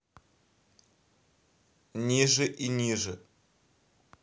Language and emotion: Russian, neutral